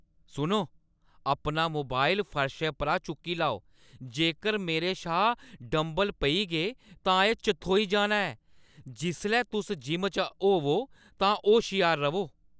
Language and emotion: Dogri, angry